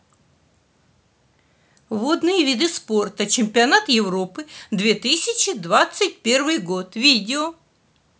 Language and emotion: Russian, neutral